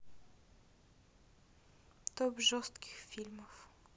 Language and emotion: Russian, neutral